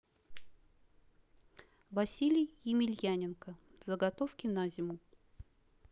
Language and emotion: Russian, neutral